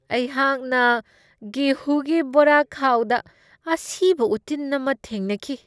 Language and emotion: Manipuri, disgusted